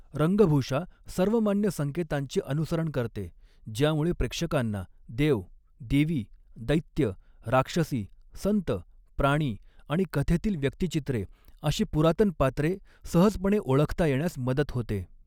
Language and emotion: Marathi, neutral